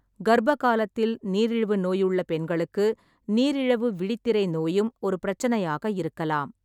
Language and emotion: Tamil, neutral